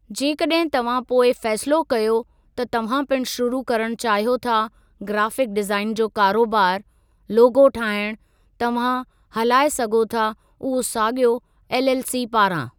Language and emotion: Sindhi, neutral